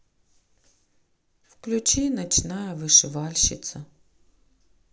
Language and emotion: Russian, sad